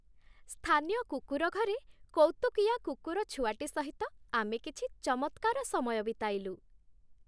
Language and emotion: Odia, happy